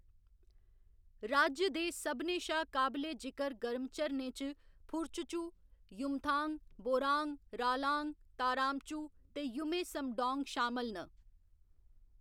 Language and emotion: Dogri, neutral